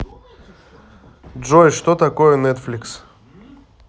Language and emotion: Russian, neutral